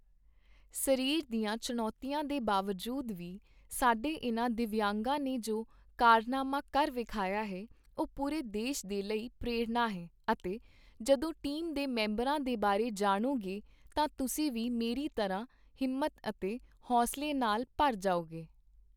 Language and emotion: Punjabi, neutral